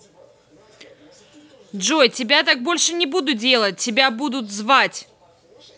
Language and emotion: Russian, angry